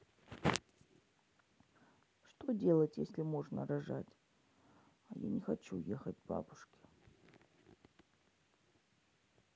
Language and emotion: Russian, sad